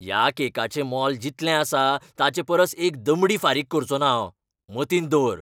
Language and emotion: Goan Konkani, angry